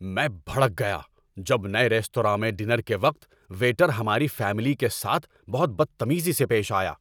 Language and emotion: Urdu, angry